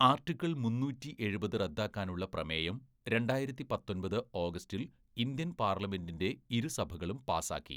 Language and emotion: Malayalam, neutral